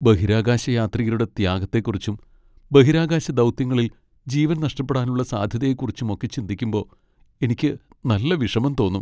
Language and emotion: Malayalam, sad